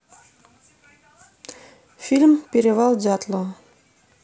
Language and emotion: Russian, neutral